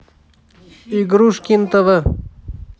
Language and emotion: Russian, neutral